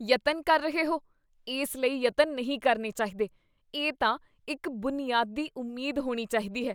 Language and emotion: Punjabi, disgusted